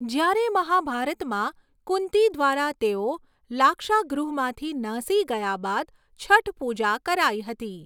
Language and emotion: Gujarati, neutral